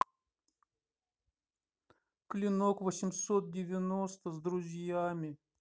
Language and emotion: Russian, sad